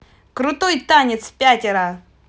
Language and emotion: Russian, positive